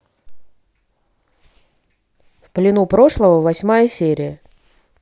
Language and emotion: Russian, neutral